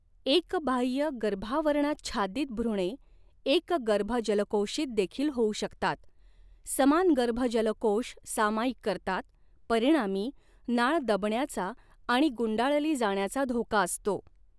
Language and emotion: Marathi, neutral